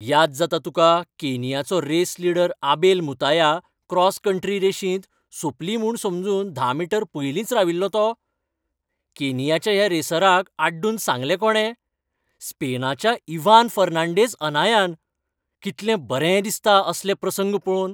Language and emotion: Goan Konkani, happy